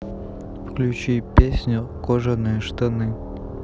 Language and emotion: Russian, neutral